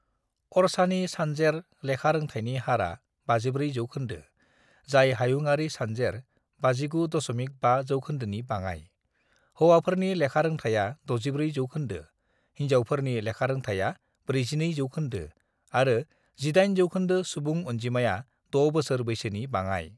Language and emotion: Bodo, neutral